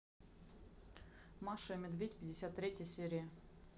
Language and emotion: Russian, neutral